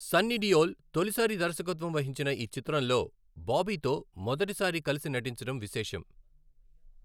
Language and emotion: Telugu, neutral